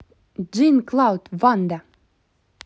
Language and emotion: Russian, positive